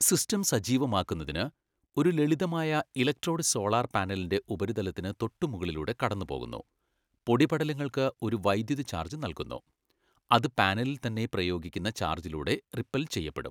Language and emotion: Malayalam, neutral